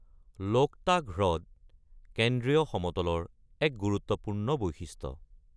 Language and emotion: Assamese, neutral